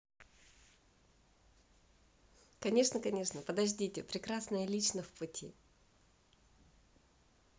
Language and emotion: Russian, positive